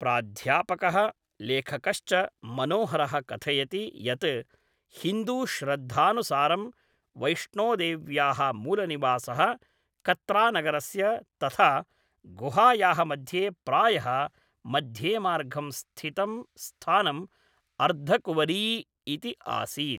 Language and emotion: Sanskrit, neutral